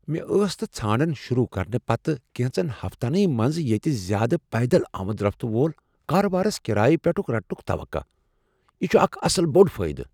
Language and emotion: Kashmiri, surprised